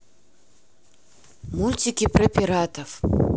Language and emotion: Russian, neutral